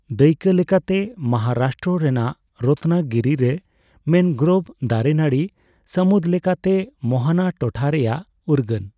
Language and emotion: Santali, neutral